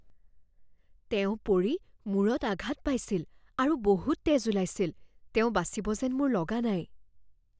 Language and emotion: Assamese, fearful